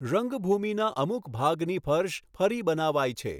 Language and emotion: Gujarati, neutral